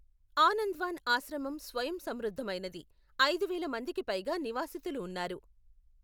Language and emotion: Telugu, neutral